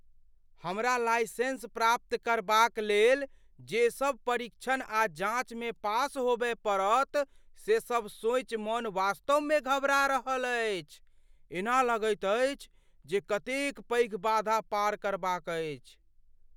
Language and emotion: Maithili, fearful